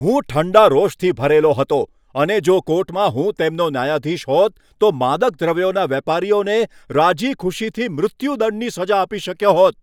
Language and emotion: Gujarati, angry